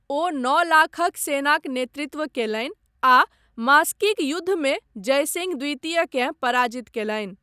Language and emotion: Maithili, neutral